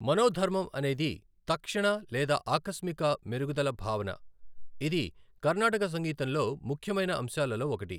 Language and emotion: Telugu, neutral